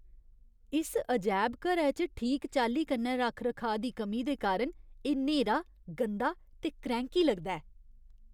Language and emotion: Dogri, disgusted